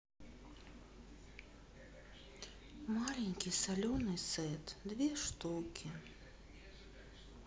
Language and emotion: Russian, sad